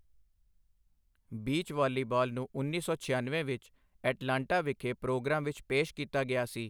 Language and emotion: Punjabi, neutral